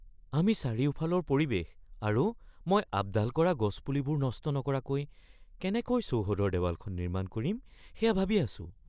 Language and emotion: Assamese, fearful